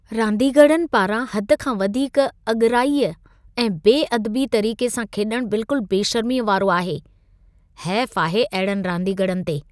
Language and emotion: Sindhi, disgusted